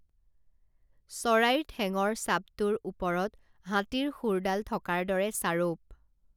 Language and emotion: Assamese, neutral